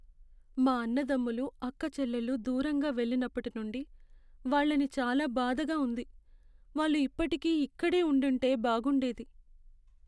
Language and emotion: Telugu, sad